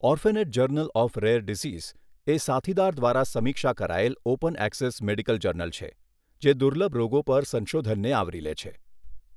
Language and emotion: Gujarati, neutral